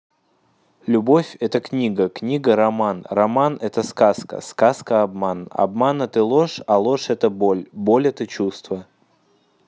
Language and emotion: Russian, neutral